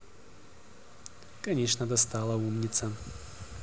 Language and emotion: Russian, neutral